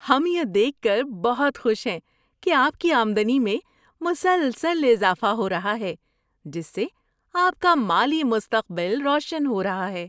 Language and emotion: Urdu, happy